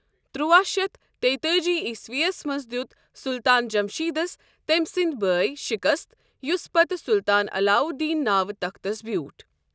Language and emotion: Kashmiri, neutral